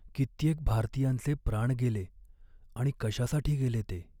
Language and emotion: Marathi, sad